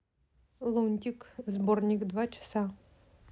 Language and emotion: Russian, neutral